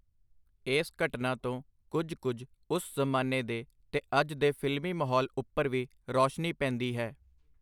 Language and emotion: Punjabi, neutral